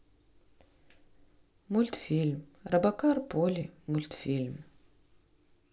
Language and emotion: Russian, neutral